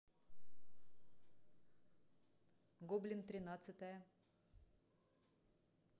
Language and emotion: Russian, neutral